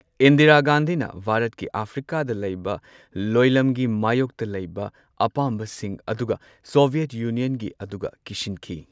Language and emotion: Manipuri, neutral